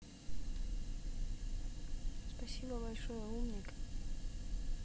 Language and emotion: Russian, neutral